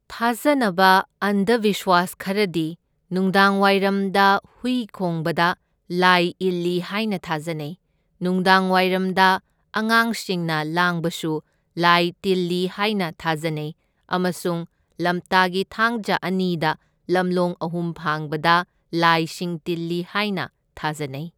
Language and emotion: Manipuri, neutral